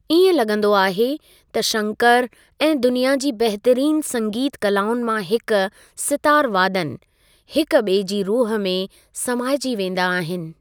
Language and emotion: Sindhi, neutral